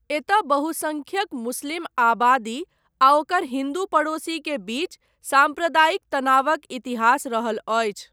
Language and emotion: Maithili, neutral